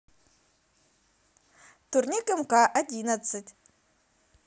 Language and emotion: Russian, positive